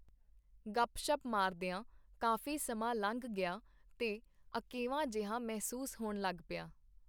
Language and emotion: Punjabi, neutral